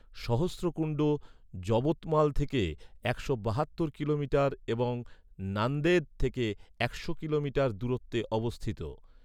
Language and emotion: Bengali, neutral